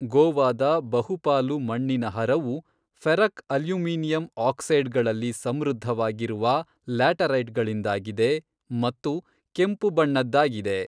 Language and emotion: Kannada, neutral